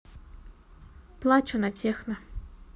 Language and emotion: Russian, neutral